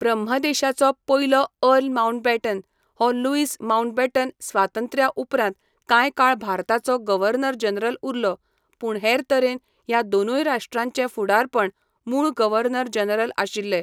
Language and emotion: Goan Konkani, neutral